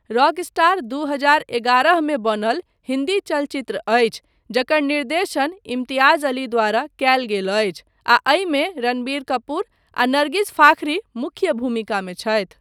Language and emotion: Maithili, neutral